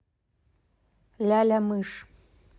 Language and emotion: Russian, neutral